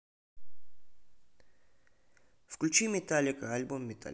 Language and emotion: Russian, neutral